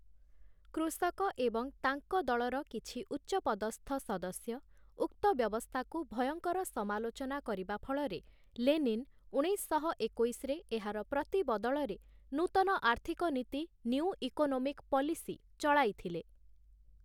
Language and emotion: Odia, neutral